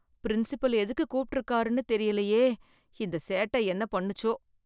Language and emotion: Tamil, fearful